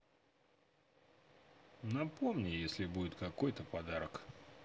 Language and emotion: Russian, neutral